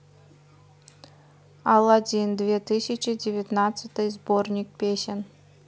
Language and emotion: Russian, neutral